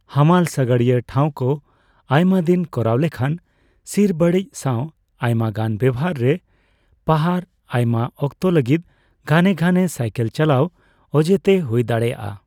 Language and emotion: Santali, neutral